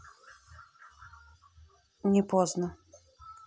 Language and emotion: Russian, neutral